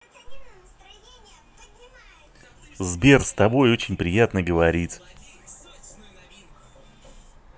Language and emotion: Russian, positive